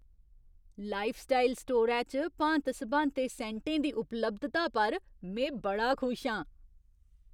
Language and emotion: Dogri, surprised